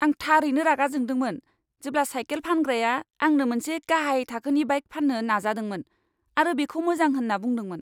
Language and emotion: Bodo, angry